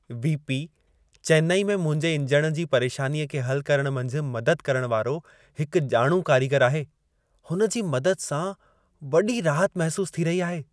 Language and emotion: Sindhi, happy